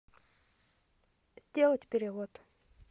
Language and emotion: Russian, neutral